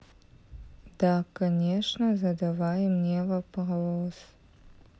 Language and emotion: Russian, sad